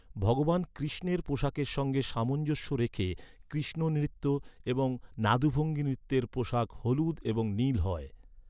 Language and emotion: Bengali, neutral